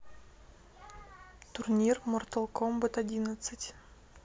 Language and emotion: Russian, neutral